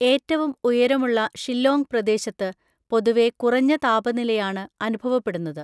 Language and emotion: Malayalam, neutral